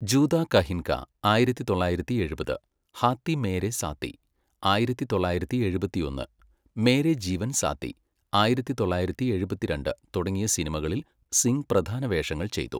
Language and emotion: Malayalam, neutral